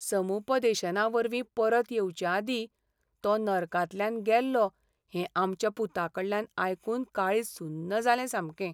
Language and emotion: Goan Konkani, sad